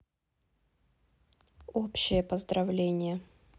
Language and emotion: Russian, neutral